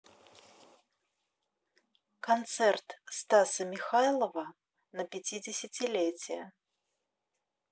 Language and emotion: Russian, neutral